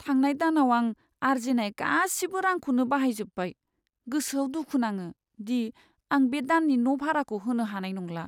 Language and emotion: Bodo, sad